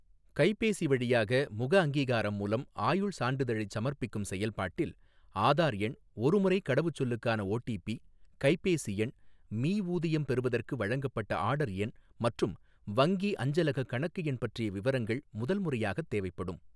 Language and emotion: Tamil, neutral